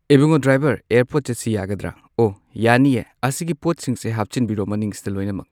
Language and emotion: Manipuri, neutral